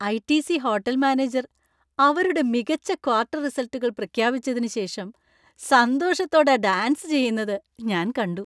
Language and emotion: Malayalam, happy